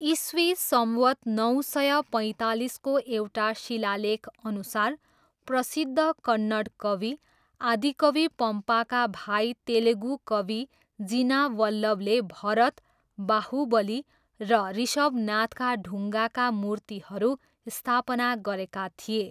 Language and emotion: Nepali, neutral